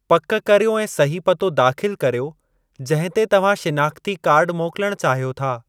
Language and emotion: Sindhi, neutral